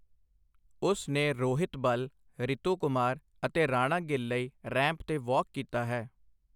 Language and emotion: Punjabi, neutral